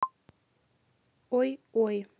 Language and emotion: Russian, neutral